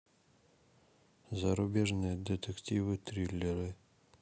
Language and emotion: Russian, neutral